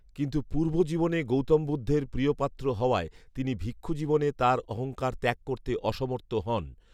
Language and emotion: Bengali, neutral